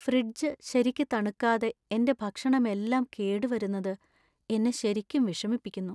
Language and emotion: Malayalam, sad